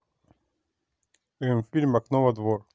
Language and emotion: Russian, neutral